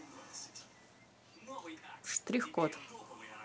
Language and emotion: Russian, neutral